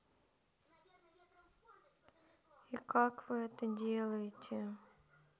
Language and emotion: Russian, sad